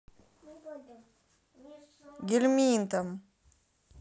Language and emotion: Russian, neutral